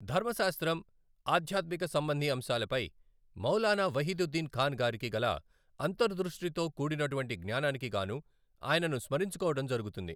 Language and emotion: Telugu, neutral